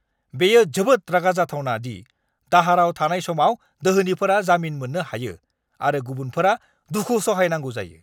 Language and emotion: Bodo, angry